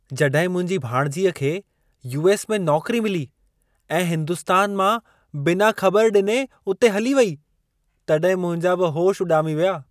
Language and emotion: Sindhi, surprised